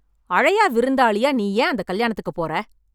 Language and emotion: Tamil, angry